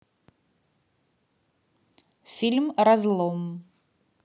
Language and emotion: Russian, neutral